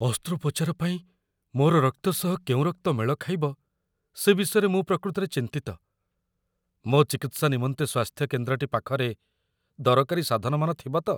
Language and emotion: Odia, fearful